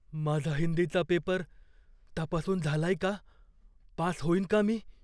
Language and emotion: Marathi, fearful